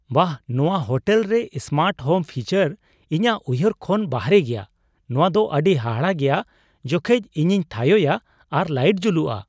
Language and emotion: Santali, surprised